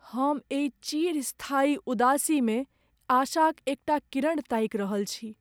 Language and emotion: Maithili, sad